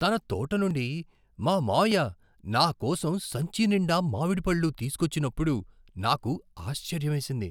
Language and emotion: Telugu, surprised